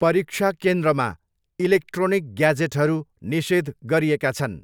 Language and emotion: Nepali, neutral